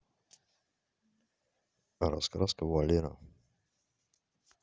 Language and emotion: Russian, neutral